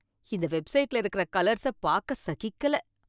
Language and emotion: Tamil, disgusted